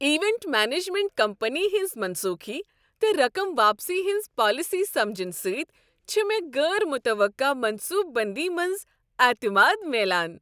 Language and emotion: Kashmiri, happy